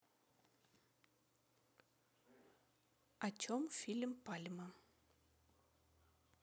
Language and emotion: Russian, neutral